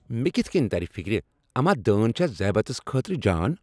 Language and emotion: Kashmiri, angry